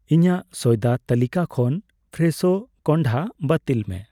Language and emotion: Santali, neutral